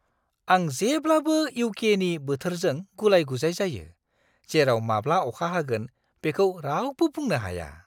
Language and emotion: Bodo, surprised